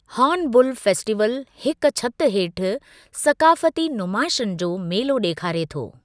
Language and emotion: Sindhi, neutral